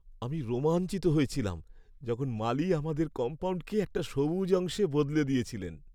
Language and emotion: Bengali, happy